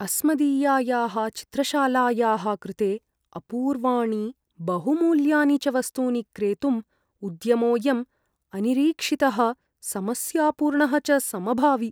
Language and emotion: Sanskrit, fearful